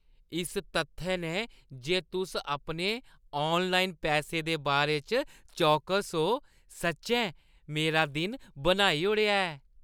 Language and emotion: Dogri, happy